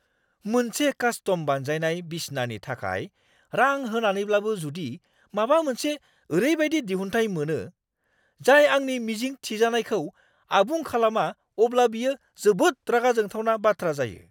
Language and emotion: Bodo, angry